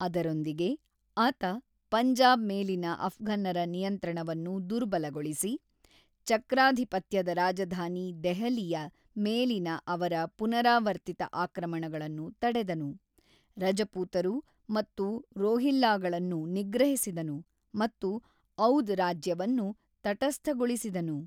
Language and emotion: Kannada, neutral